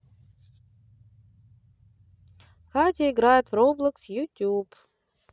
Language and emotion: Russian, neutral